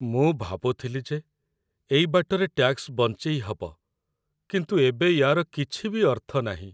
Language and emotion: Odia, sad